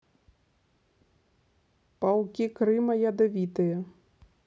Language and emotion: Russian, neutral